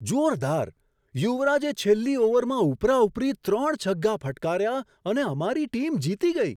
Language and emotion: Gujarati, surprised